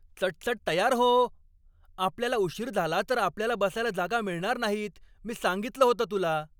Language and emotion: Marathi, angry